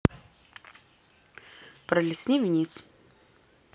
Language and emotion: Russian, neutral